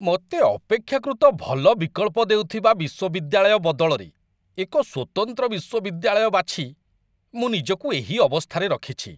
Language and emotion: Odia, disgusted